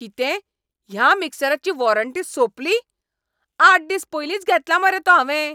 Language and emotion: Goan Konkani, angry